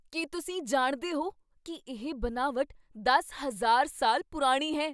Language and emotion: Punjabi, surprised